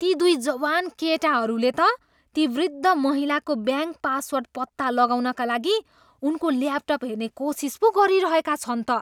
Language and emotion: Nepali, disgusted